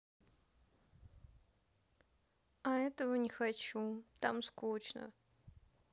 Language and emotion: Russian, sad